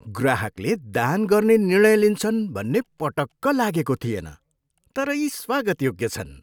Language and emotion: Nepali, surprised